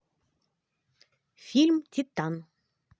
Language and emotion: Russian, positive